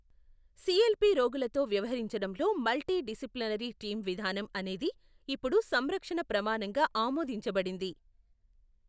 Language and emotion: Telugu, neutral